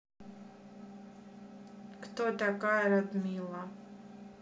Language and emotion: Russian, neutral